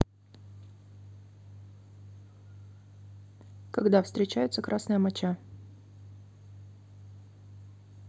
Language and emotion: Russian, neutral